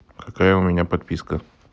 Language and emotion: Russian, neutral